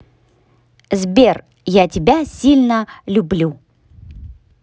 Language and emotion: Russian, positive